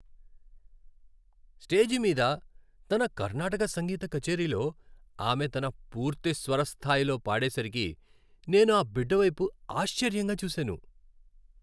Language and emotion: Telugu, happy